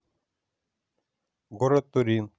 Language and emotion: Russian, neutral